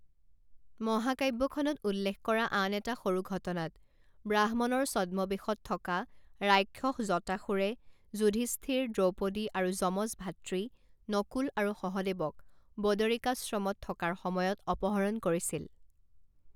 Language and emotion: Assamese, neutral